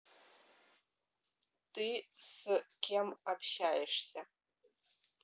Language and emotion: Russian, neutral